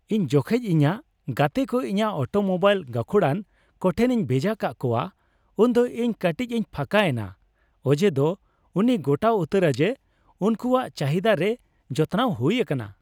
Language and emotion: Santali, happy